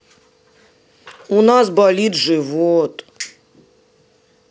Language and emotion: Russian, sad